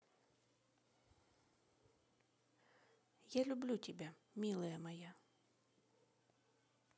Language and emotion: Russian, positive